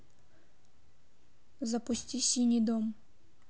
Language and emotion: Russian, neutral